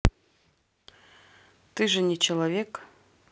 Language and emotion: Russian, neutral